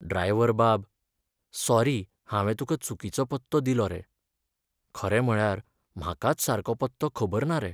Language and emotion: Goan Konkani, sad